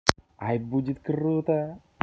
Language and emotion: Russian, positive